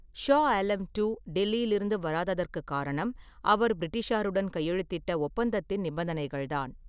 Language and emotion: Tamil, neutral